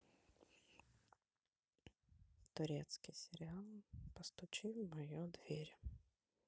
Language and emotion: Russian, sad